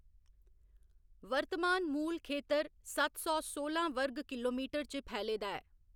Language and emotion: Dogri, neutral